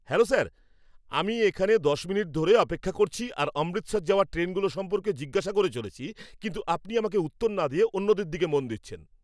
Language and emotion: Bengali, angry